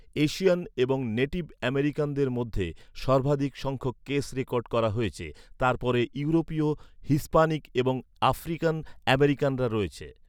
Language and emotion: Bengali, neutral